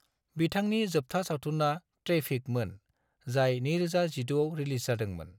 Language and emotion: Bodo, neutral